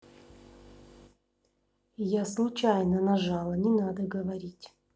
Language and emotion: Russian, neutral